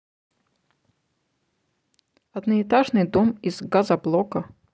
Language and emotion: Russian, neutral